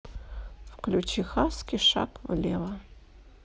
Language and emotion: Russian, neutral